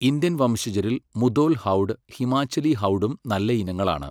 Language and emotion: Malayalam, neutral